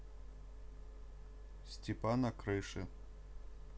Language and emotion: Russian, neutral